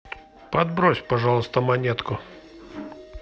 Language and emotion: Russian, neutral